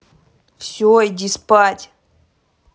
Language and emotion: Russian, angry